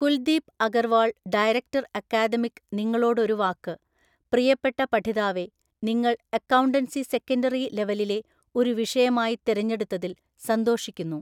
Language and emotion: Malayalam, neutral